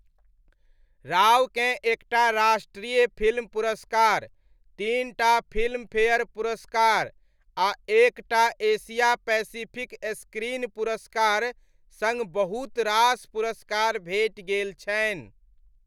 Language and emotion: Maithili, neutral